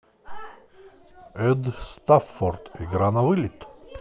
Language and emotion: Russian, positive